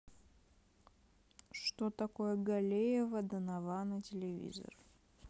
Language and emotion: Russian, neutral